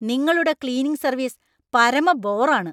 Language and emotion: Malayalam, angry